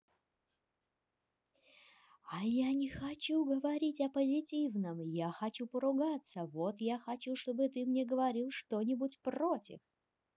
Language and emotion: Russian, neutral